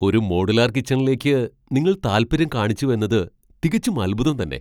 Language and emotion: Malayalam, surprised